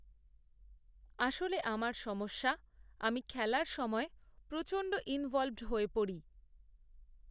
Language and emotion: Bengali, neutral